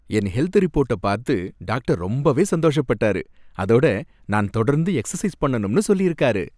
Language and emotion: Tamil, happy